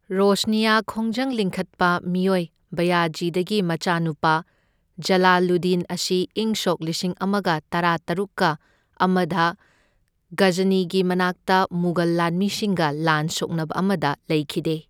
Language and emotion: Manipuri, neutral